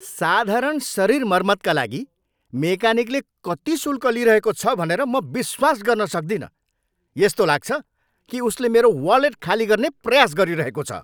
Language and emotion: Nepali, angry